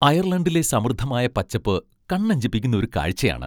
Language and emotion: Malayalam, happy